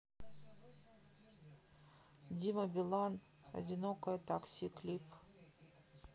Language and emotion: Russian, sad